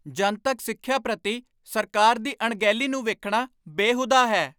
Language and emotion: Punjabi, angry